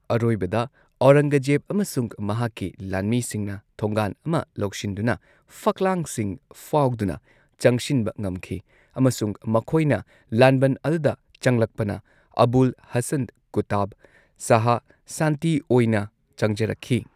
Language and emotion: Manipuri, neutral